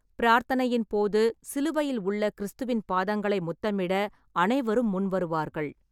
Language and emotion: Tamil, neutral